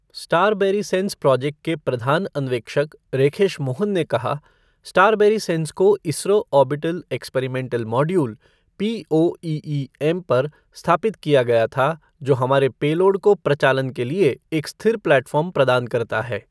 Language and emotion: Hindi, neutral